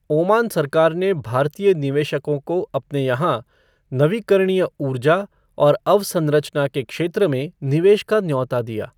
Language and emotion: Hindi, neutral